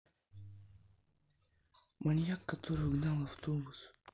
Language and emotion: Russian, neutral